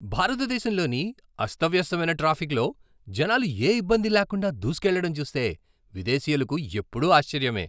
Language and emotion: Telugu, surprised